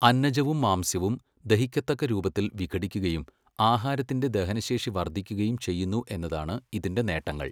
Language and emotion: Malayalam, neutral